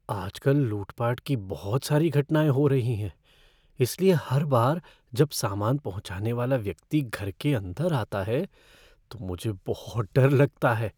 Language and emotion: Hindi, fearful